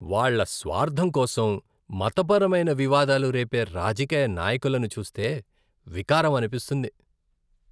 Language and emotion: Telugu, disgusted